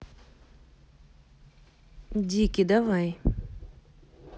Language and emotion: Russian, neutral